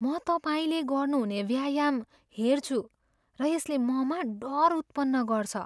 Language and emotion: Nepali, fearful